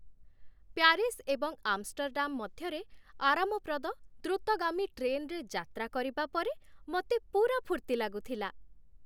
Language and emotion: Odia, happy